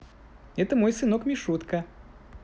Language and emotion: Russian, positive